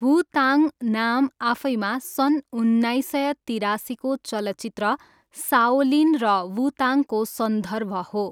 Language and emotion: Nepali, neutral